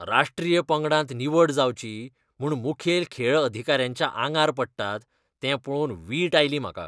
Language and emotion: Goan Konkani, disgusted